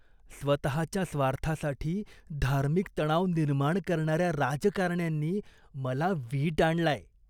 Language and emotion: Marathi, disgusted